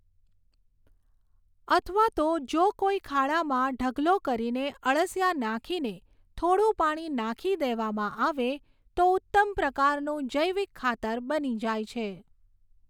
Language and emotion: Gujarati, neutral